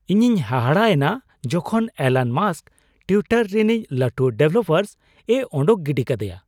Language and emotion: Santali, surprised